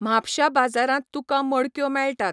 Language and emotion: Goan Konkani, neutral